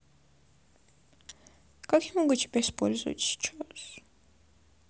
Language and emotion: Russian, sad